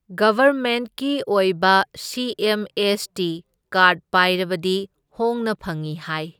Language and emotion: Manipuri, neutral